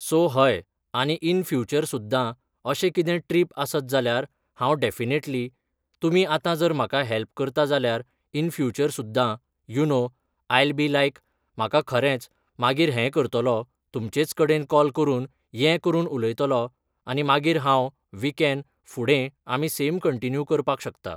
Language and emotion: Goan Konkani, neutral